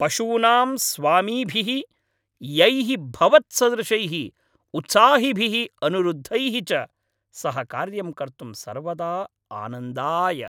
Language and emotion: Sanskrit, happy